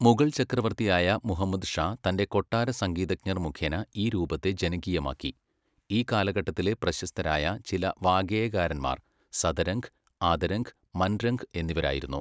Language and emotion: Malayalam, neutral